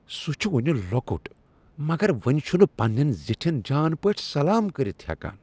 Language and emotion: Kashmiri, disgusted